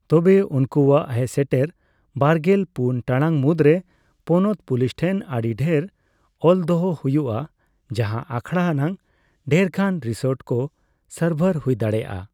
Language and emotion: Santali, neutral